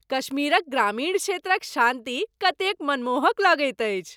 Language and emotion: Maithili, happy